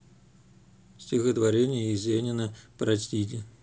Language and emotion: Russian, neutral